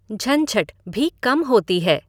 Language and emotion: Hindi, neutral